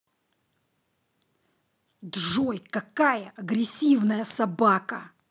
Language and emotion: Russian, angry